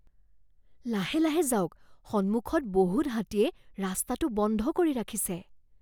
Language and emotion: Assamese, fearful